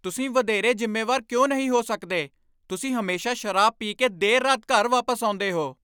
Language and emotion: Punjabi, angry